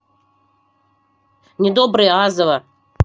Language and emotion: Russian, angry